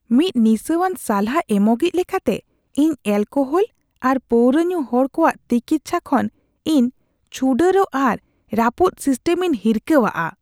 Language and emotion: Santali, disgusted